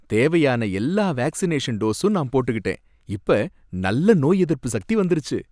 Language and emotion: Tamil, happy